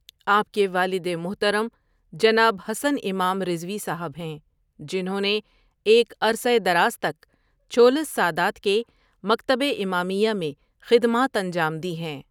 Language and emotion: Urdu, neutral